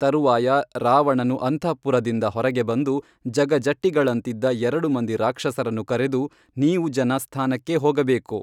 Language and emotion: Kannada, neutral